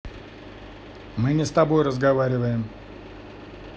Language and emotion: Russian, angry